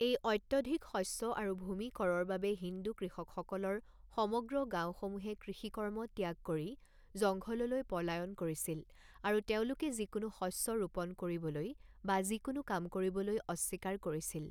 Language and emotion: Assamese, neutral